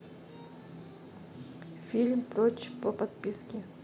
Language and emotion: Russian, neutral